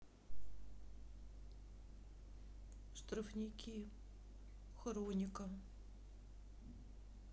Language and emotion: Russian, sad